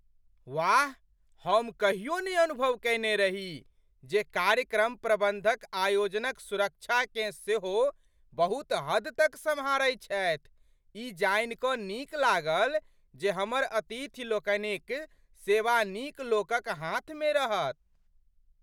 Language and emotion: Maithili, surprised